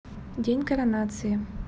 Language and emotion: Russian, neutral